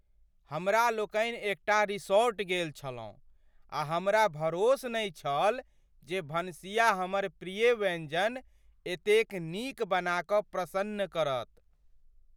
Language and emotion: Maithili, surprised